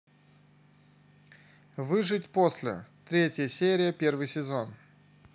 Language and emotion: Russian, neutral